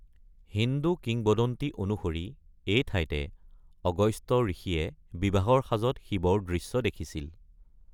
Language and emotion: Assamese, neutral